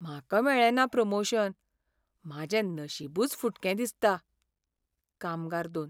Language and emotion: Goan Konkani, sad